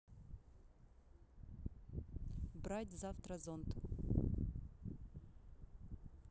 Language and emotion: Russian, neutral